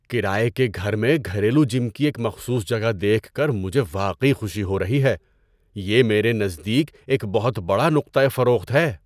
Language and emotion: Urdu, surprised